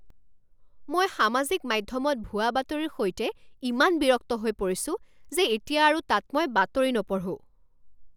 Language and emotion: Assamese, angry